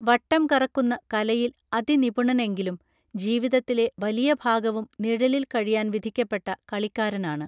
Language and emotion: Malayalam, neutral